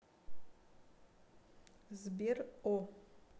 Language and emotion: Russian, neutral